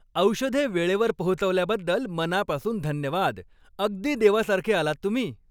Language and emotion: Marathi, happy